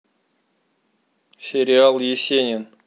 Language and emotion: Russian, neutral